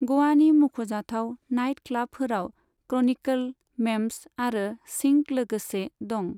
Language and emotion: Bodo, neutral